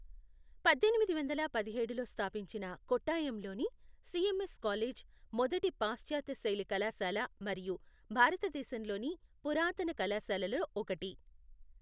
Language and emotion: Telugu, neutral